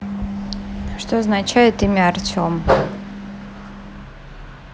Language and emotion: Russian, neutral